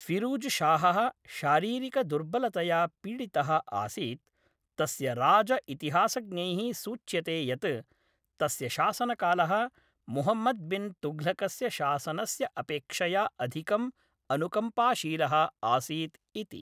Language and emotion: Sanskrit, neutral